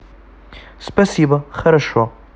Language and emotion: Russian, neutral